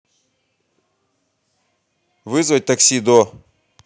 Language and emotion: Russian, angry